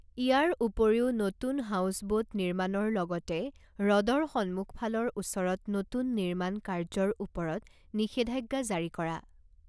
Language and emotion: Assamese, neutral